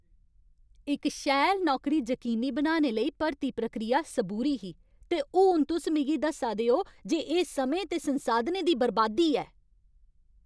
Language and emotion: Dogri, angry